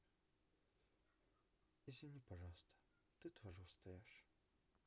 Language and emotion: Russian, sad